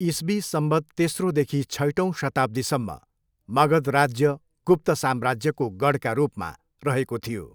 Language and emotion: Nepali, neutral